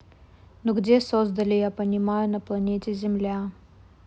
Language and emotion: Russian, neutral